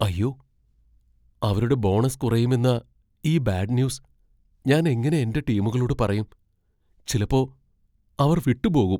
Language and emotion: Malayalam, fearful